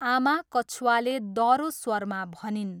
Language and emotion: Nepali, neutral